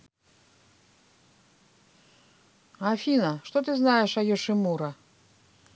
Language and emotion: Russian, neutral